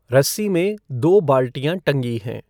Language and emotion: Hindi, neutral